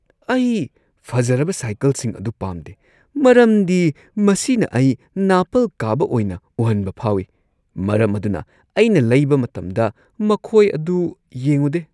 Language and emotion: Manipuri, disgusted